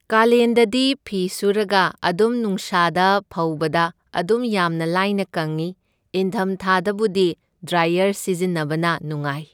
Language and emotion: Manipuri, neutral